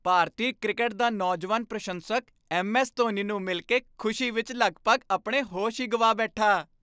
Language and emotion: Punjabi, happy